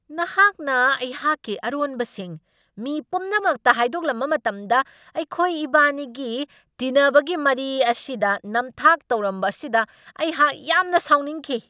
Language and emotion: Manipuri, angry